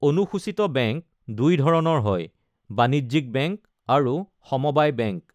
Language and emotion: Assamese, neutral